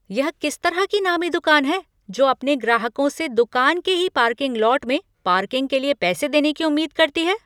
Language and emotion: Hindi, angry